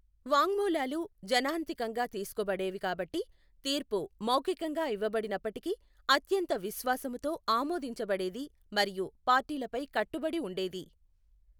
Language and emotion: Telugu, neutral